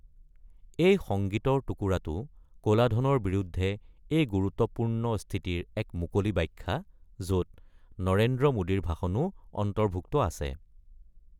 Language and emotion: Assamese, neutral